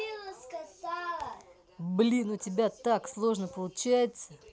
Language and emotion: Russian, positive